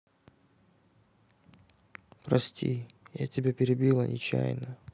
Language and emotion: Russian, sad